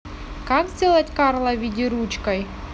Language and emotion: Russian, neutral